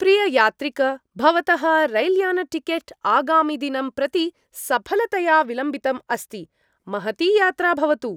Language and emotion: Sanskrit, happy